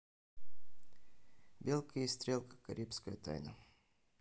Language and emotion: Russian, neutral